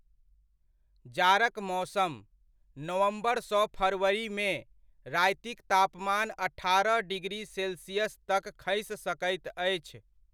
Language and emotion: Maithili, neutral